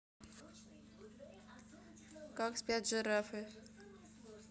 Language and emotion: Russian, neutral